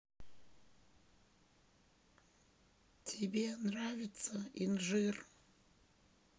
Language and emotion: Russian, sad